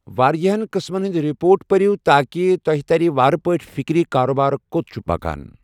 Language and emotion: Kashmiri, neutral